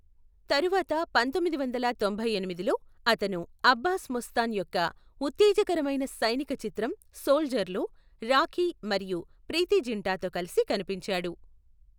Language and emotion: Telugu, neutral